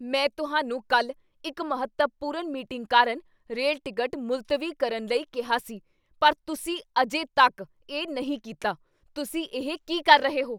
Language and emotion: Punjabi, angry